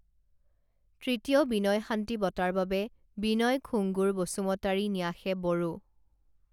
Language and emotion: Assamese, neutral